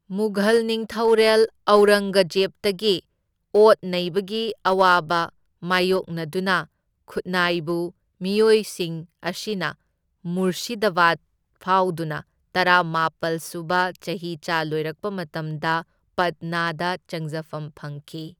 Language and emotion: Manipuri, neutral